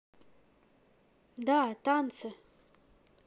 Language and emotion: Russian, neutral